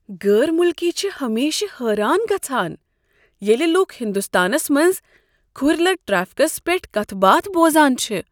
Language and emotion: Kashmiri, surprised